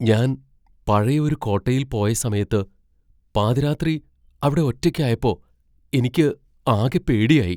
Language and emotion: Malayalam, fearful